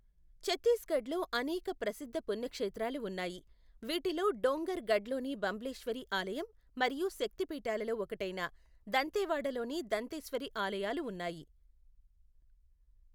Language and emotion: Telugu, neutral